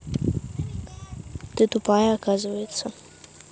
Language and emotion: Russian, angry